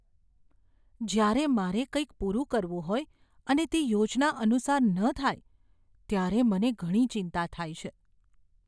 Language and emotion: Gujarati, fearful